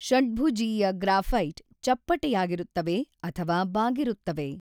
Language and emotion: Kannada, neutral